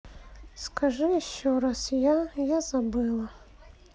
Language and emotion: Russian, sad